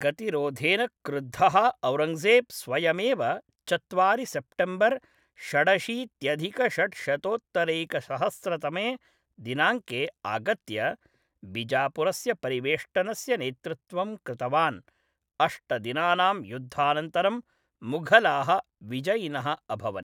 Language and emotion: Sanskrit, neutral